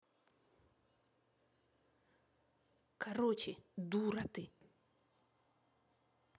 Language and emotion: Russian, angry